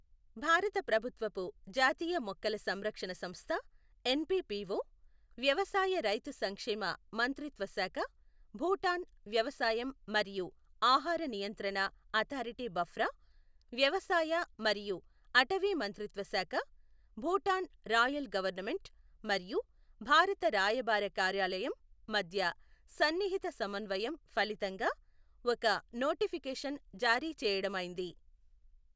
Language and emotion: Telugu, neutral